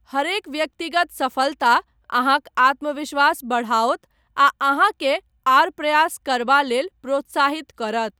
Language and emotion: Maithili, neutral